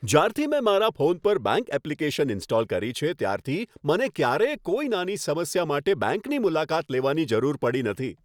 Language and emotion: Gujarati, happy